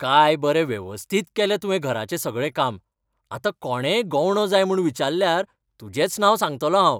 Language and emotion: Goan Konkani, happy